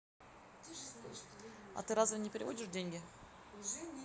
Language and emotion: Russian, neutral